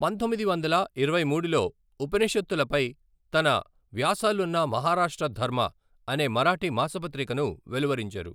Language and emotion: Telugu, neutral